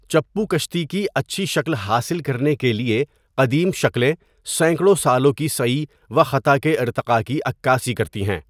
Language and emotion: Urdu, neutral